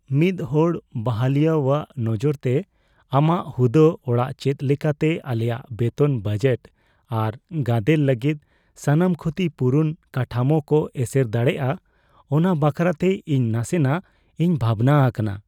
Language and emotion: Santali, fearful